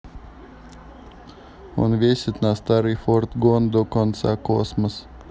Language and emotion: Russian, neutral